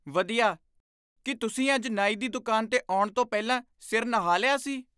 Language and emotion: Punjabi, surprised